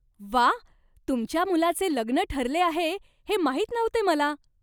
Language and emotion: Marathi, surprised